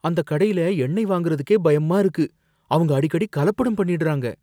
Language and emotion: Tamil, fearful